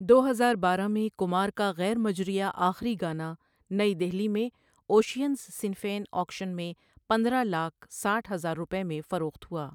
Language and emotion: Urdu, neutral